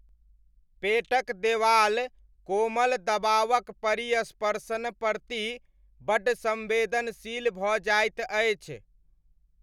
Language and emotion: Maithili, neutral